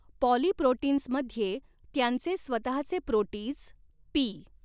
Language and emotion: Marathi, neutral